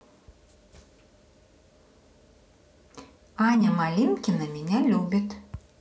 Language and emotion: Russian, positive